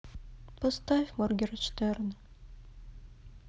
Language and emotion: Russian, sad